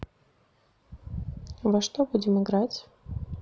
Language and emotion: Russian, neutral